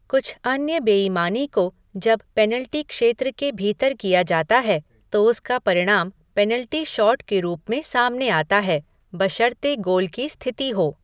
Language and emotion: Hindi, neutral